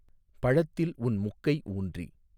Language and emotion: Tamil, neutral